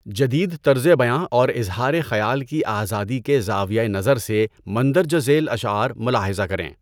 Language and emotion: Urdu, neutral